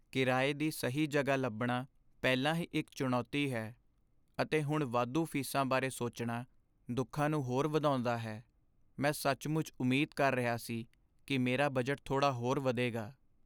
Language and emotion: Punjabi, sad